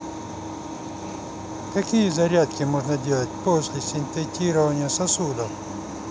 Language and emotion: Russian, neutral